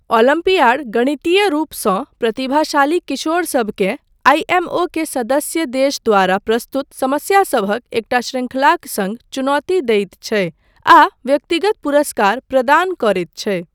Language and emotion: Maithili, neutral